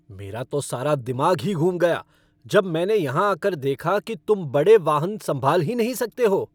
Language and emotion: Hindi, angry